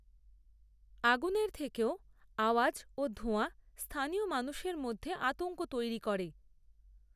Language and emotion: Bengali, neutral